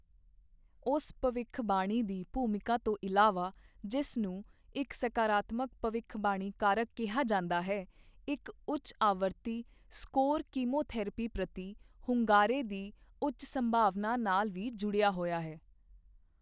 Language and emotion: Punjabi, neutral